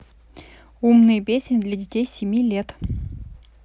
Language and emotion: Russian, neutral